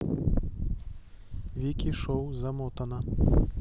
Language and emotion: Russian, neutral